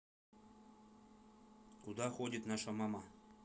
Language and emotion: Russian, neutral